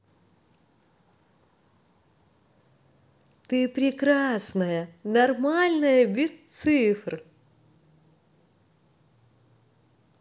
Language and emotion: Russian, positive